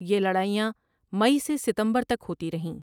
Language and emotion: Urdu, neutral